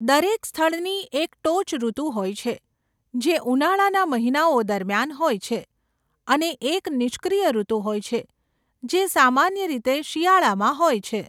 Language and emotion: Gujarati, neutral